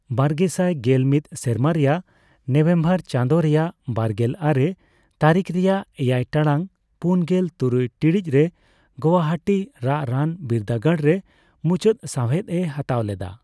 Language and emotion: Santali, neutral